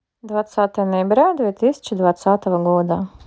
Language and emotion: Russian, neutral